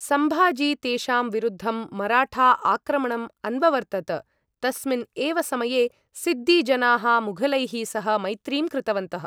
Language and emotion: Sanskrit, neutral